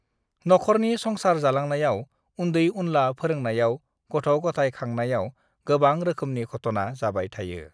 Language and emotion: Bodo, neutral